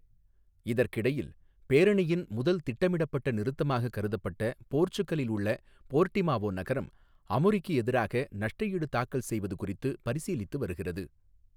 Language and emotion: Tamil, neutral